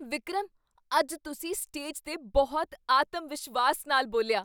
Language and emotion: Punjabi, surprised